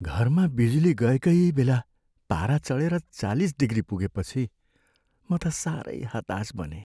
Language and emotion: Nepali, sad